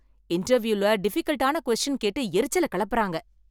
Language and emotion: Tamil, angry